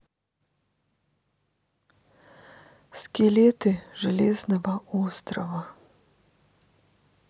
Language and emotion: Russian, sad